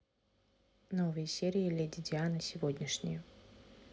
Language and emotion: Russian, neutral